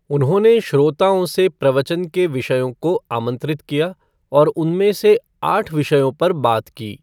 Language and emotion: Hindi, neutral